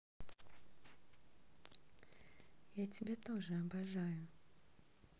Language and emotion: Russian, neutral